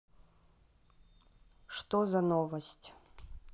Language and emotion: Russian, neutral